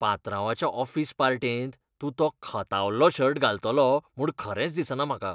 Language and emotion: Goan Konkani, disgusted